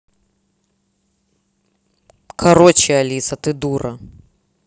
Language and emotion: Russian, angry